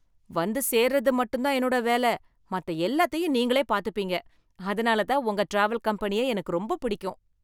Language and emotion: Tamil, happy